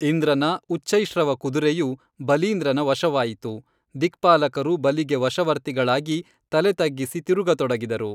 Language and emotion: Kannada, neutral